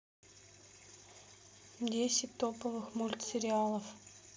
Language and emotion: Russian, neutral